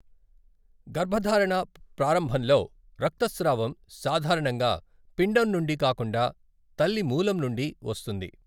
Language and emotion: Telugu, neutral